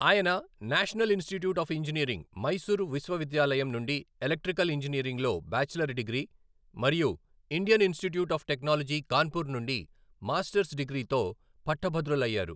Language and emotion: Telugu, neutral